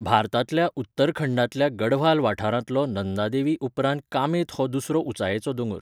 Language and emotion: Goan Konkani, neutral